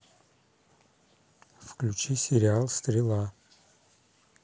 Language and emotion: Russian, neutral